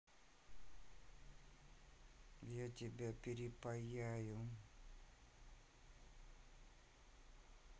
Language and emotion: Russian, neutral